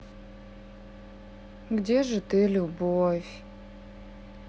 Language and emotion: Russian, sad